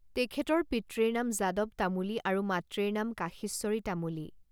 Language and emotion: Assamese, neutral